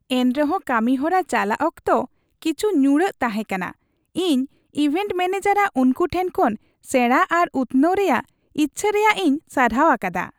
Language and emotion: Santali, happy